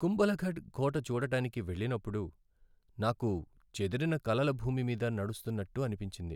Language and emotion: Telugu, sad